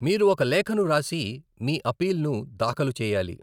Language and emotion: Telugu, neutral